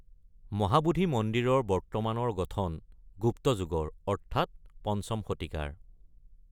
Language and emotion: Assamese, neutral